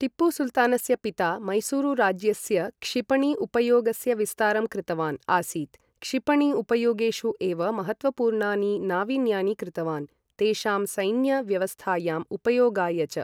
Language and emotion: Sanskrit, neutral